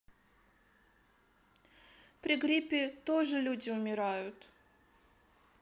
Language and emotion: Russian, sad